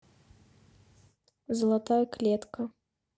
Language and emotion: Russian, neutral